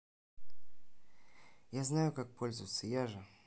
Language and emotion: Russian, neutral